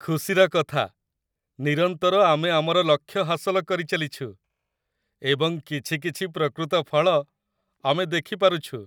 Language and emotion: Odia, happy